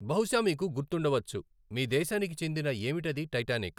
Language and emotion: Telugu, neutral